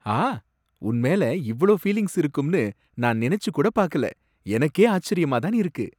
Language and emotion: Tamil, surprised